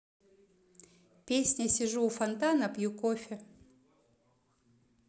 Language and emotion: Russian, neutral